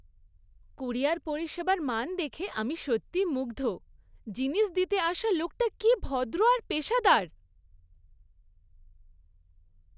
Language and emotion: Bengali, happy